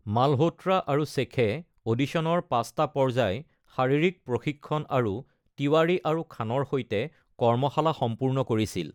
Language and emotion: Assamese, neutral